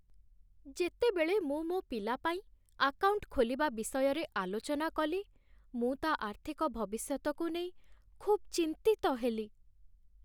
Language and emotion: Odia, sad